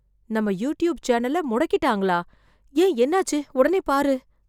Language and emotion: Tamil, fearful